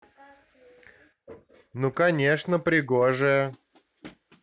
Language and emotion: Russian, neutral